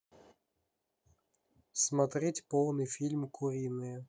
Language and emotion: Russian, neutral